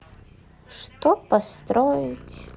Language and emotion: Russian, sad